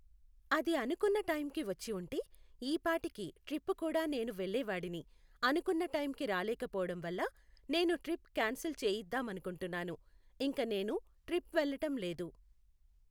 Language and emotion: Telugu, neutral